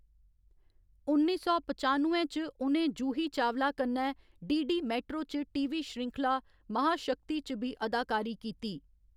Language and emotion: Dogri, neutral